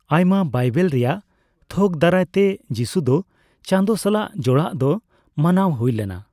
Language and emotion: Santali, neutral